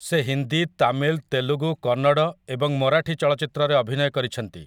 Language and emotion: Odia, neutral